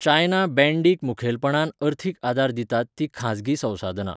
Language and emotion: Goan Konkani, neutral